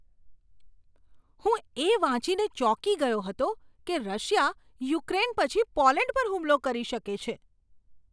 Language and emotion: Gujarati, surprised